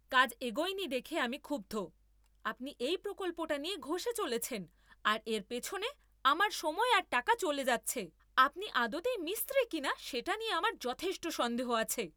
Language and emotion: Bengali, angry